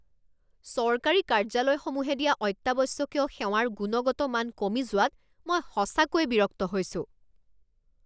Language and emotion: Assamese, angry